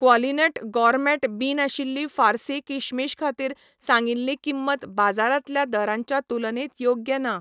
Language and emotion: Goan Konkani, neutral